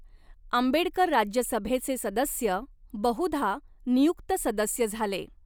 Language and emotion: Marathi, neutral